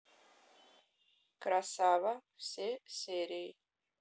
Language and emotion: Russian, neutral